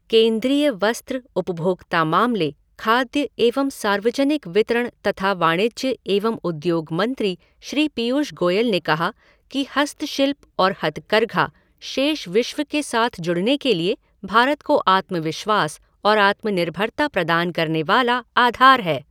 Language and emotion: Hindi, neutral